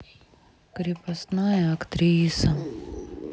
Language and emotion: Russian, sad